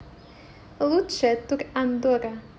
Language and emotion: Russian, positive